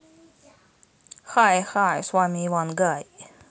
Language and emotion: Russian, positive